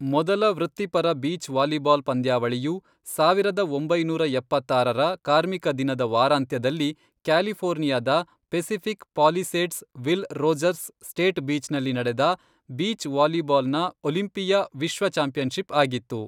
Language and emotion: Kannada, neutral